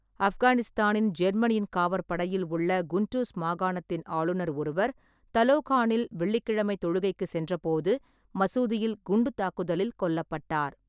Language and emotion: Tamil, neutral